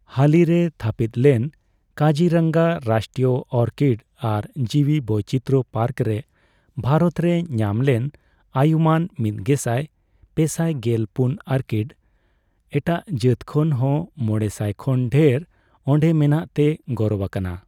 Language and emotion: Santali, neutral